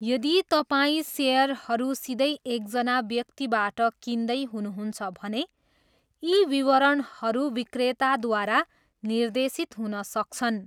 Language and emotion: Nepali, neutral